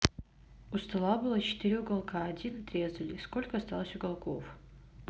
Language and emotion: Russian, neutral